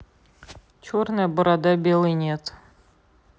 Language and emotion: Russian, neutral